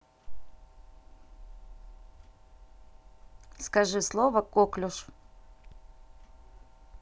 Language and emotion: Russian, neutral